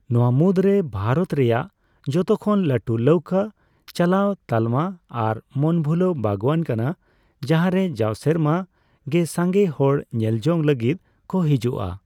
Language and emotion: Santali, neutral